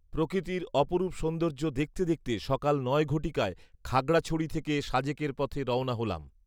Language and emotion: Bengali, neutral